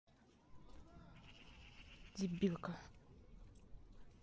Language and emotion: Russian, angry